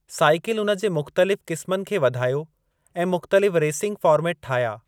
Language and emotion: Sindhi, neutral